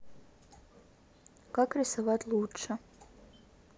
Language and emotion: Russian, neutral